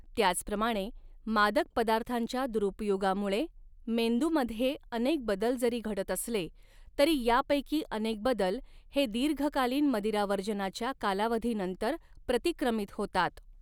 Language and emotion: Marathi, neutral